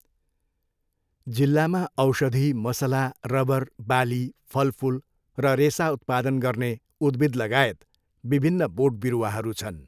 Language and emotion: Nepali, neutral